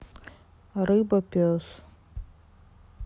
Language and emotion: Russian, sad